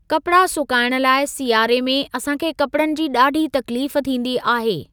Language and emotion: Sindhi, neutral